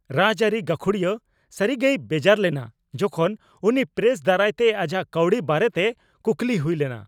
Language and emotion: Santali, angry